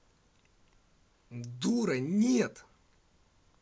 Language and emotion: Russian, angry